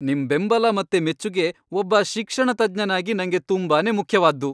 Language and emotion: Kannada, happy